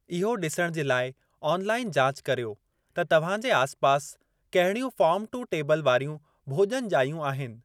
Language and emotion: Sindhi, neutral